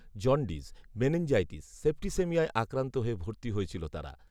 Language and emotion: Bengali, neutral